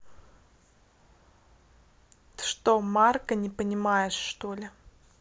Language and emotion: Russian, neutral